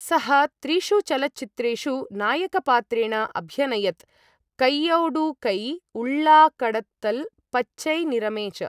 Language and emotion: Sanskrit, neutral